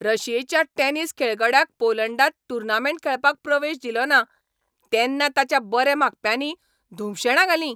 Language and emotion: Goan Konkani, angry